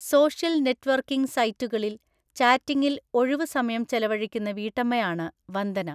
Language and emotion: Malayalam, neutral